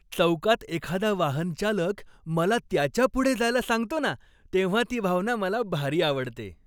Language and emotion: Marathi, happy